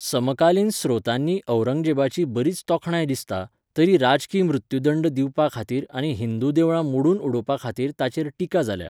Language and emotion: Goan Konkani, neutral